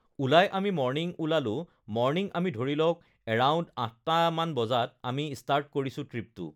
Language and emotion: Assamese, neutral